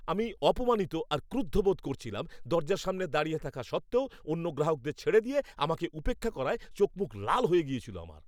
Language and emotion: Bengali, angry